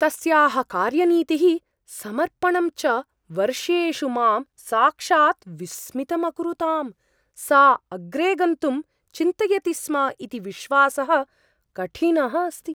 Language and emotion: Sanskrit, surprised